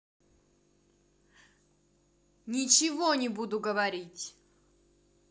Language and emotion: Russian, angry